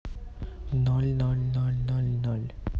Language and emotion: Russian, neutral